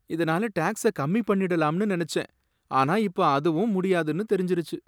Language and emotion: Tamil, sad